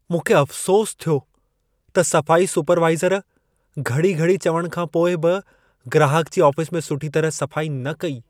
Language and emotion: Sindhi, sad